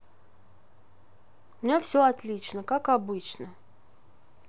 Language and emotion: Russian, neutral